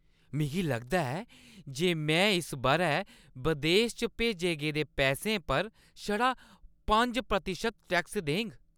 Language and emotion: Dogri, happy